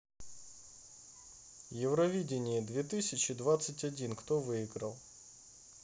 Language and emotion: Russian, neutral